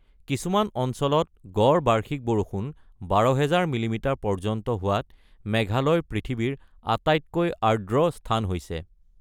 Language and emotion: Assamese, neutral